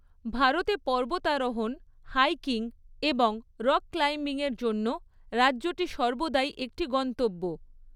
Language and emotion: Bengali, neutral